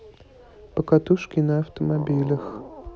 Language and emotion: Russian, neutral